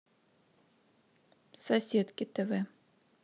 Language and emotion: Russian, neutral